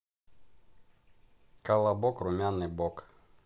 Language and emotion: Russian, neutral